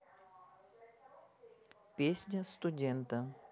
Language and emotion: Russian, neutral